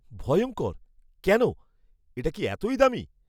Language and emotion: Bengali, fearful